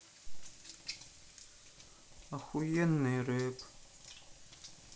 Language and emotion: Russian, sad